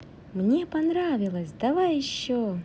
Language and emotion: Russian, positive